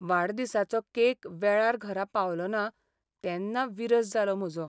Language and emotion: Goan Konkani, sad